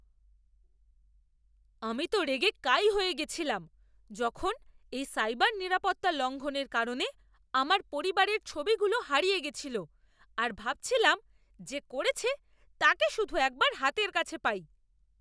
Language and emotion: Bengali, angry